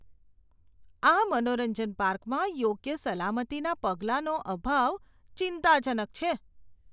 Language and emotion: Gujarati, disgusted